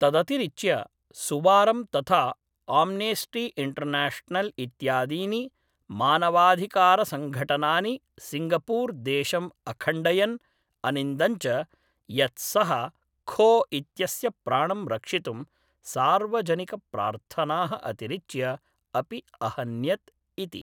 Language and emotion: Sanskrit, neutral